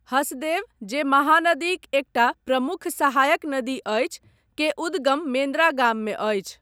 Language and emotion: Maithili, neutral